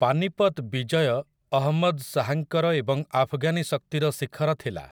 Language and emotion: Odia, neutral